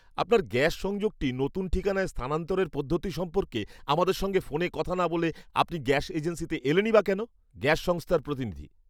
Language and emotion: Bengali, angry